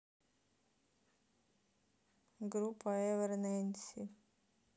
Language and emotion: Russian, sad